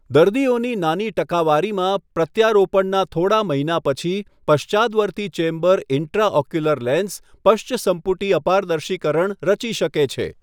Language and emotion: Gujarati, neutral